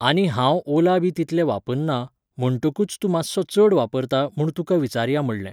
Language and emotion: Goan Konkani, neutral